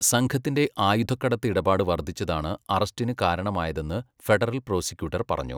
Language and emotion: Malayalam, neutral